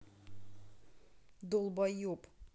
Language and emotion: Russian, angry